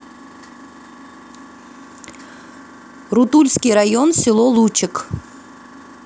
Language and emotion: Russian, neutral